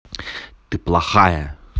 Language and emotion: Russian, angry